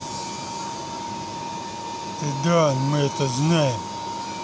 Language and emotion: Russian, neutral